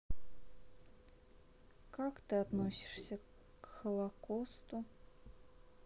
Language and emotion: Russian, sad